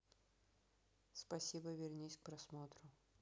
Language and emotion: Russian, neutral